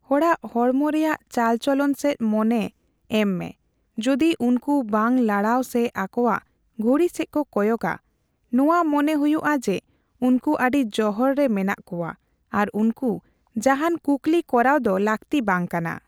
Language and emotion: Santali, neutral